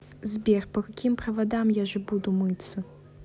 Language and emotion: Russian, neutral